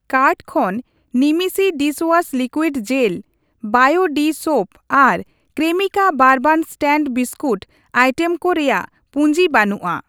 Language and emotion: Santali, neutral